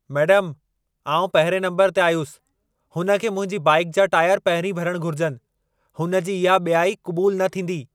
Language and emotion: Sindhi, angry